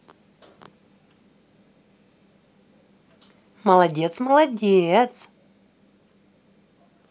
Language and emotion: Russian, positive